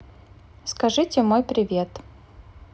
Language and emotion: Russian, neutral